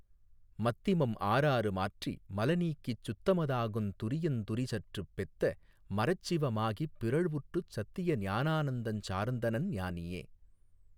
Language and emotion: Tamil, neutral